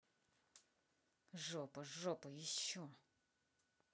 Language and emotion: Russian, angry